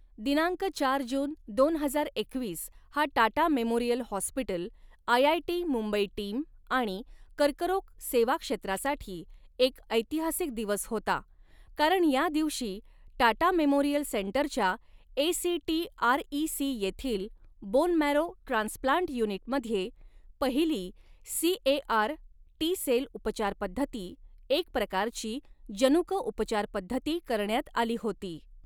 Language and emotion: Marathi, neutral